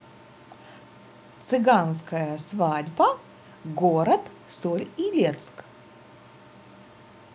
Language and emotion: Russian, neutral